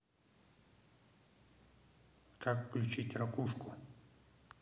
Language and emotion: Russian, neutral